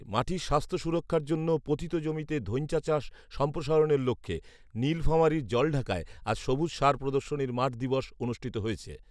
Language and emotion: Bengali, neutral